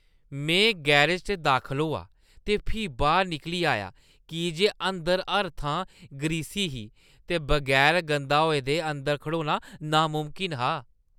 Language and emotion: Dogri, disgusted